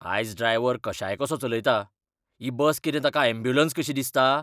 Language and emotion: Goan Konkani, angry